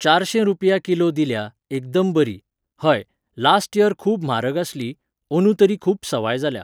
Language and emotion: Goan Konkani, neutral